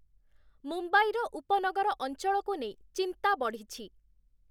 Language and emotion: Odia, neutral